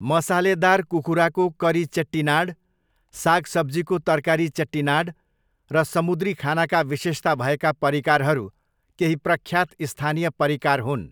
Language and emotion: Nepali, neutral